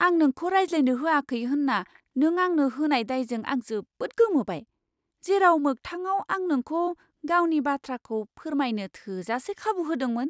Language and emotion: Bodo, surprised